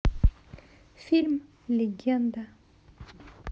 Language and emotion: Russian, neutral